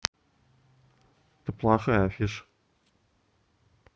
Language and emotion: Russian, neutral